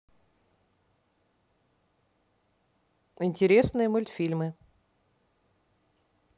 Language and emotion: Russian, neutral